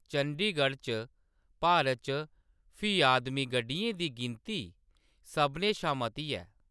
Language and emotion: Dogri, neutral